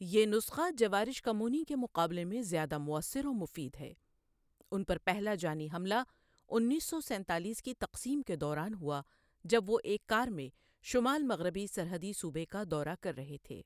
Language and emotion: Urdu, neutral